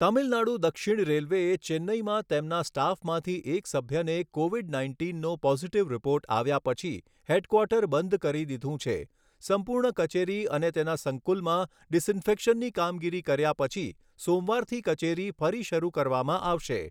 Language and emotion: Gujarati, neutral